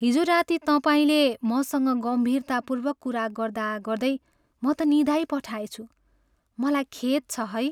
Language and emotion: Nepali, sad